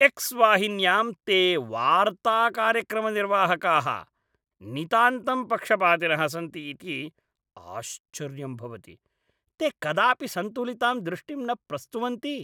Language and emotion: Sanskrit, disgusted